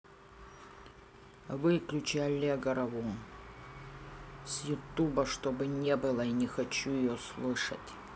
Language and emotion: Russian, angry